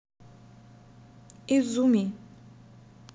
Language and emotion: Russian, neutral